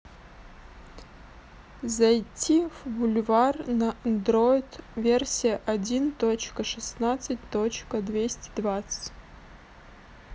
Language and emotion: Russian, neutral